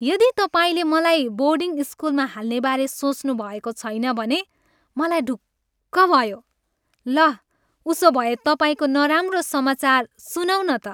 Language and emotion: Nepali, happy